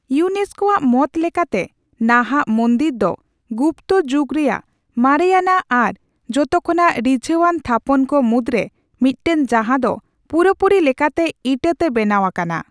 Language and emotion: Santali, neutral